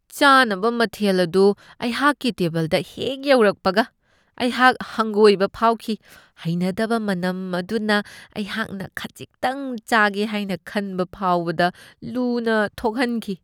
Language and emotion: Manipuri, disgusted